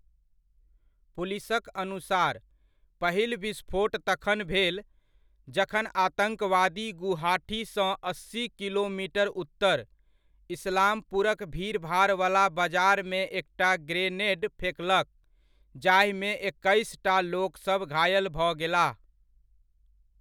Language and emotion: Maithili, neutral